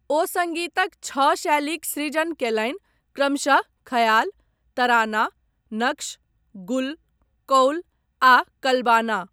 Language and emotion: Maithili, neutral